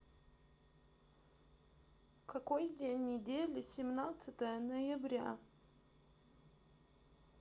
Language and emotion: Russian, sad